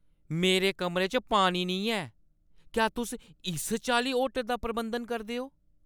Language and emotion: Dogri, angry